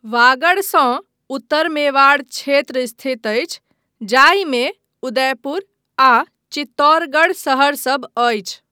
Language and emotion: Maithili, neutral